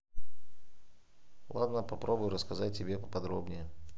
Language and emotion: Russian, neutral